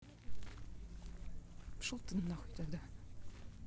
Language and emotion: Russian, angry